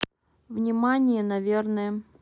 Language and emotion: Russian, neutral